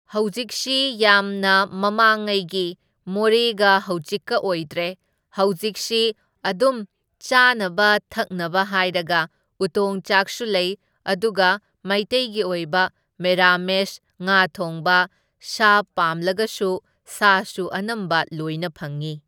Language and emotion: Manipuri, neutral